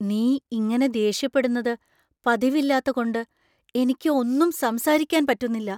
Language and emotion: Malayalam, surprised